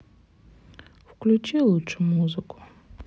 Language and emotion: Russian, sad